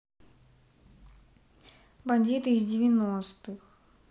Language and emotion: Russian, neutral